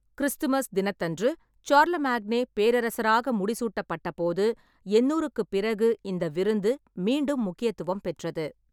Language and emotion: Tamil, neutral